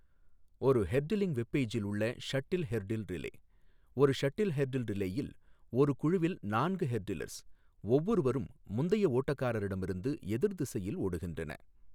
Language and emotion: Tamil, neutral